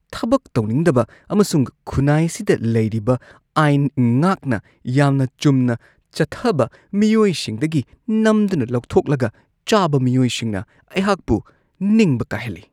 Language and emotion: Manipuri, disgusted